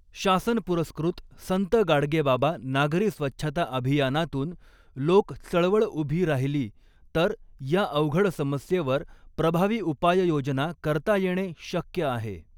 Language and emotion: Marathi, neutral